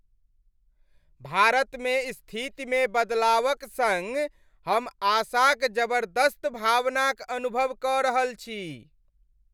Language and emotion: Maithili, happy